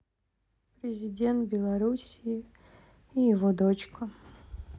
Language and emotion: Russian, sad